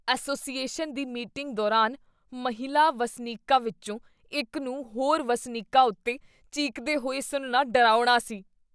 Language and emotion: Punjabi, disgusted